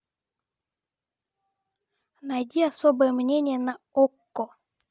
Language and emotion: Russian, neutral